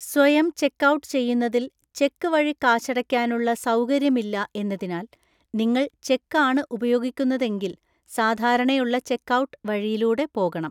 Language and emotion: Malayalam, neutral